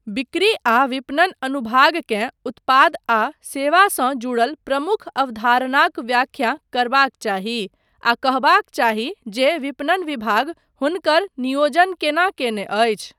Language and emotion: Maithili, neutral